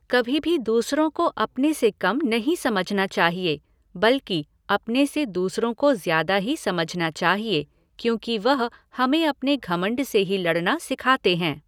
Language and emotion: Hindi, neutral